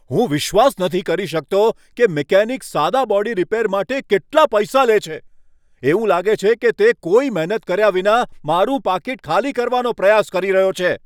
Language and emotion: Gujarati, angry